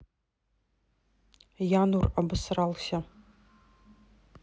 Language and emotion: Russian, neutral